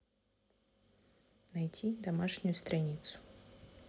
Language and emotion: Russian, neutral